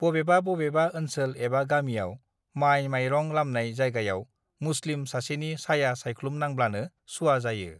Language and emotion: Bodo, neutral